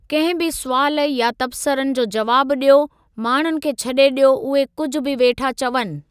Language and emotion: Sindhi, neutral